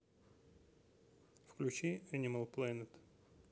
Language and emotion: Russian, neutral